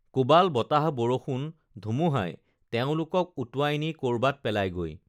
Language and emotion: Assamese, neutral